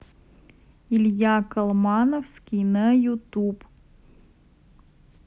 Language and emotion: Russian, neutral